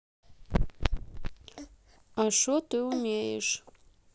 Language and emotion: Russian, neutral